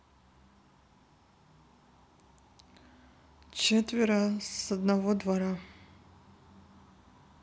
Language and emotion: Russian, neutral